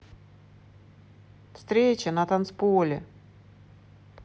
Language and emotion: Russian, positive